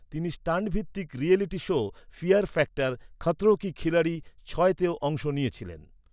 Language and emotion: Bengali, neutral